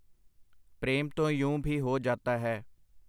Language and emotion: Punjabi, neutral